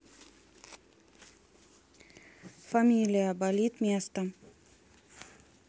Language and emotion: Russian, neutral